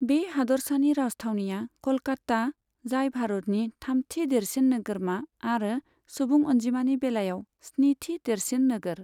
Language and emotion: Bodo, neutral